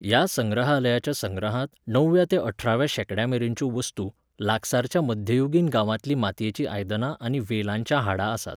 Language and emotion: Goan Konkani, neutral